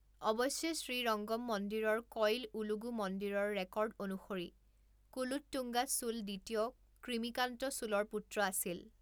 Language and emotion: Assamese, neutral